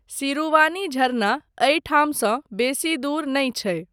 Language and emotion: Maithili, neutral